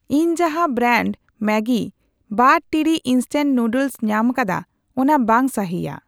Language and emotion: Santali, neutral